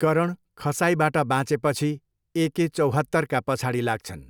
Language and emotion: Nepali, neutral